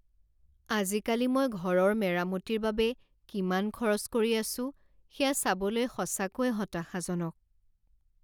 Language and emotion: Assamese, sad